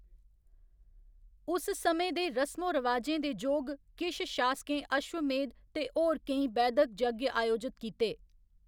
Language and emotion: Dogri, neutral